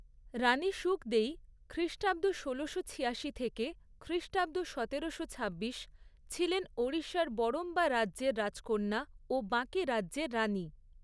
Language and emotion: Bengali, neutral